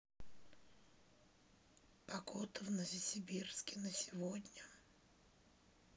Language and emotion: Russian, sad